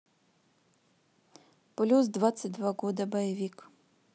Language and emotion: Russian, neutral